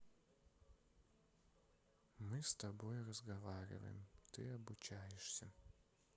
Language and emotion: Russian, neutral